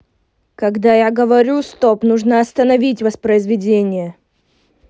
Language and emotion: Russian, angry